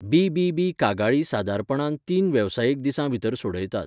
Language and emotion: Goan Konkani, neutral